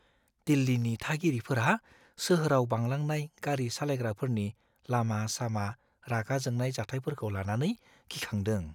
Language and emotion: Bodo, fearful